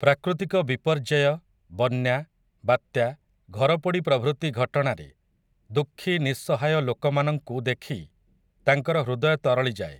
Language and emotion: Odia, neutral